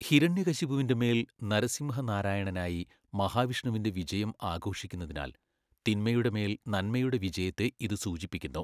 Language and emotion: Malayalam, neutral